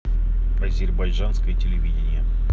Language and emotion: Russian, neutral